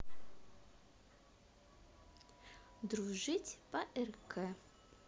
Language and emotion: Russian, positive